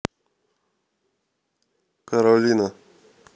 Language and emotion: Russian, neutral